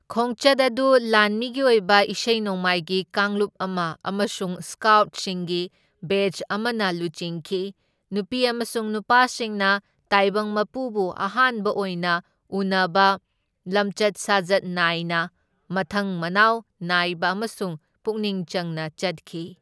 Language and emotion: Manipuri, neutral